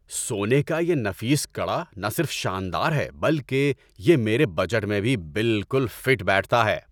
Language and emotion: Urdu, happy